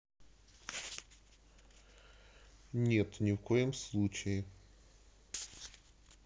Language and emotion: Russian, neutral